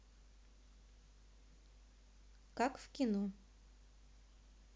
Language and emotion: Russian, neutral